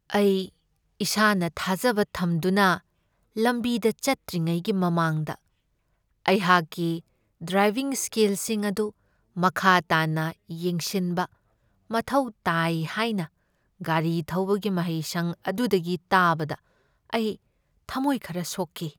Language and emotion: Manipuri, sad